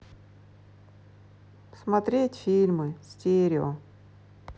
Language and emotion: Russian, sad